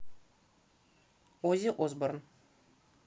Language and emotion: Russian, neutral